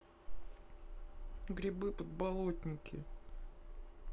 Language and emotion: Russian, neutral